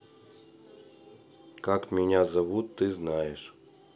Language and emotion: Russian, neutral